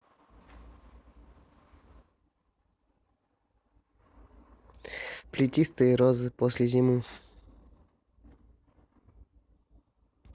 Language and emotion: Russian, neutral